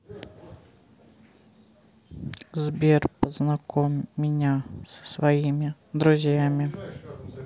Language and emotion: Russian, sad